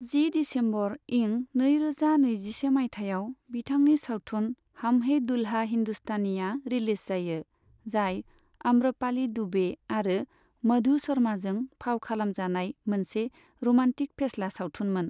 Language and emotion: Bodo, neutral